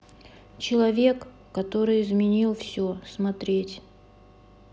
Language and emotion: Russian, neutral